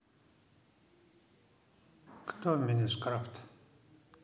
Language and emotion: Russian, neutral